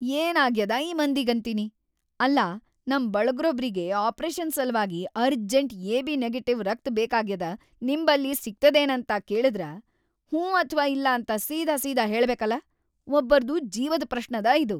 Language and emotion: Kannada, angry